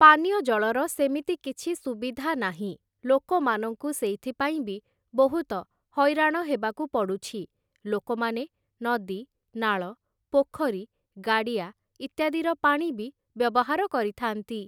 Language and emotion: Odia, neutral